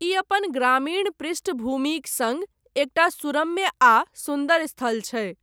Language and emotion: Maithili, neutral